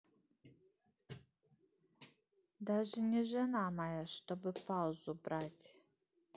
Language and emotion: Russian, neutral